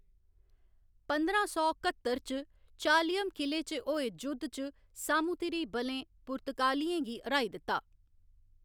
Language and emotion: Dogri, neutral